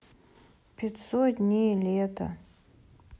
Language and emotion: Russian, sad